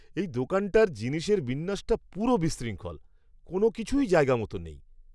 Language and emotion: Bengali, disgusted